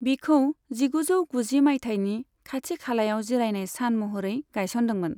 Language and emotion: Bodo, neutral